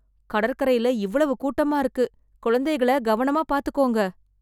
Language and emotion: Tamil, fearful